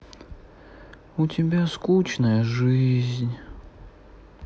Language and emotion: Russian, sad